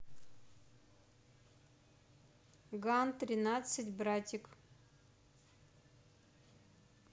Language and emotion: Russian, neutral